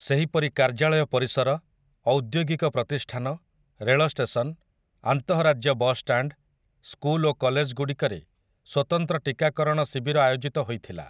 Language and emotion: Odia, neutral